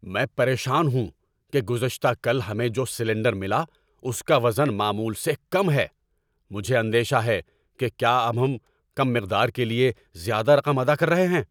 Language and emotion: Urdu, angry